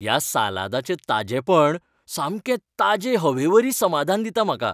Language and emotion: Goan Konkani, happy